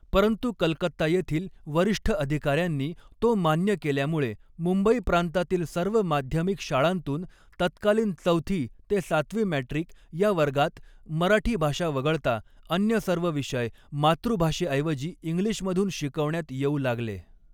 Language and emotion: Marathi, neutral